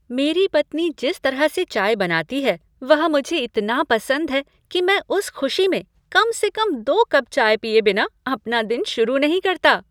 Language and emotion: Hindi, happy